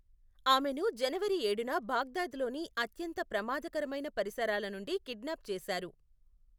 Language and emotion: Telugu, neutral